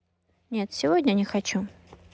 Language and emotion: Russian, neutral